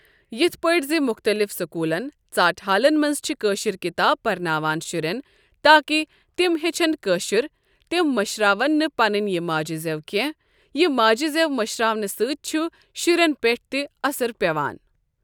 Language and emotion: Kashmiri, neutral